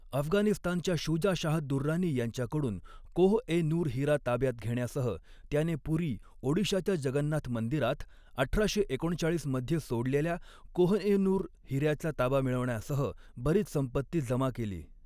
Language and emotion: Marathi, neutral